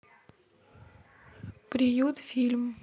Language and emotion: Russian, neutral